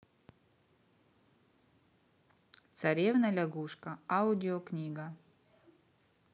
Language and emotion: Russian, neutral